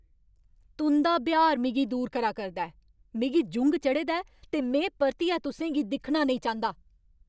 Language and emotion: Dogri, angry